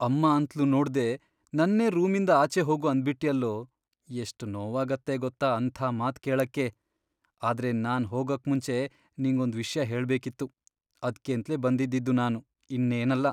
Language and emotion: Kannada, sad